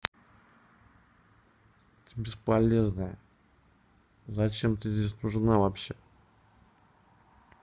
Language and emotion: Russian, angry